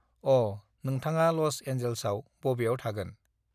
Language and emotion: Bodo, neutral